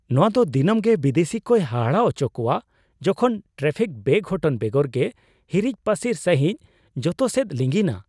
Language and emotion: Santali, surprised